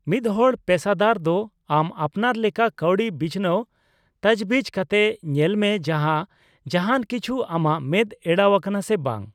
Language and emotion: Santali, neutral